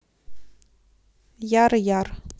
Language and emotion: Russian, neutral